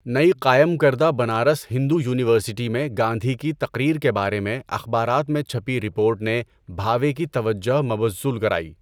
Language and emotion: Urdu, neutral